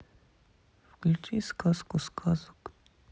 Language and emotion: Russian, sad